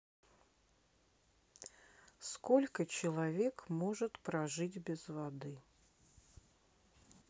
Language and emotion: Russian, neutral